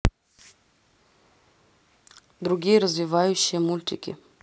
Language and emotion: Russian, neutral